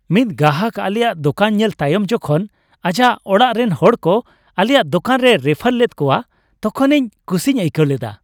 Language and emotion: Santali, happy